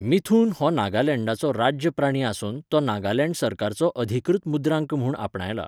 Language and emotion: Goan Konkani, neutral